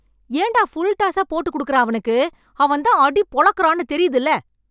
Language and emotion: Tamil, angry